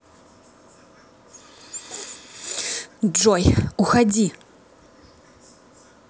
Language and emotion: Russian, angry